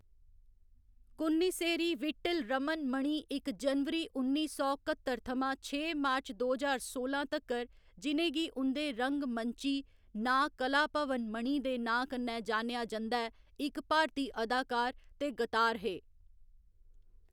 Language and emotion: Dogri, neutral